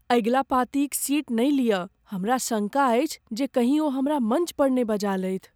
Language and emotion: Maithili, fearful